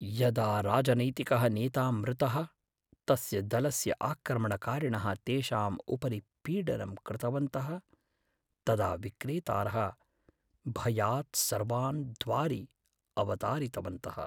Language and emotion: Sanskrit, fearful